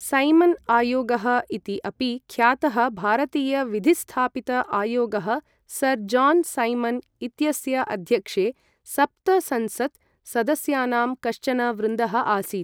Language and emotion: Sanskrit, neutral